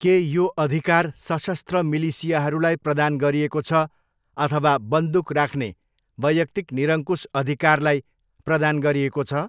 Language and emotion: Nepali, neutral